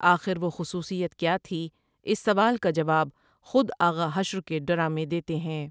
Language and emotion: Urdu, neutral